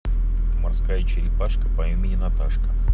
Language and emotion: Russian, neutral